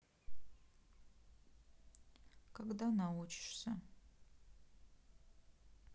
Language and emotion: Russian, sad